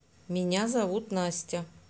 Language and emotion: Russian, neutral